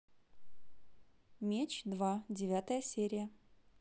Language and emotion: Russian, positive